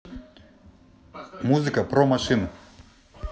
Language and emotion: Russian, neutral